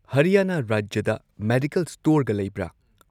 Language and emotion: Manipuri, neutral